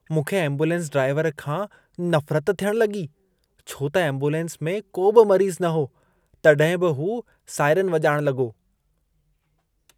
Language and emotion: Sindhi, disgusted